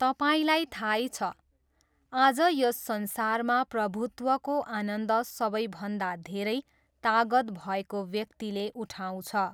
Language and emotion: Nepali, neutral